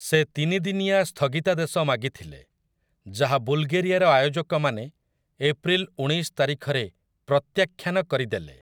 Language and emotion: Odia, neutral